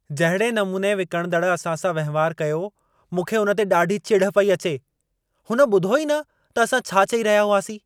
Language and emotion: Sindhi, angry